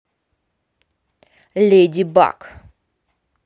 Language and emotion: Russian, neutral